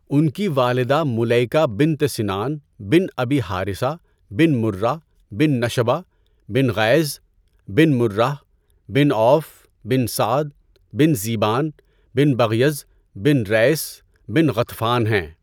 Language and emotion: Urdu, neutral